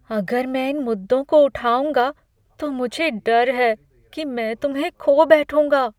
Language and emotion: Hindi, fearful